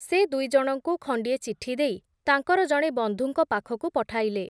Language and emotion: Odia, neutral